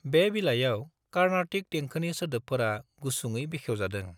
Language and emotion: Bodo, neutral